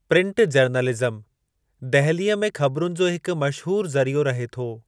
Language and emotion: Sindhi, neutral